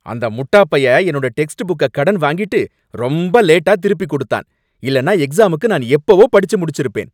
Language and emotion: Tamil, angry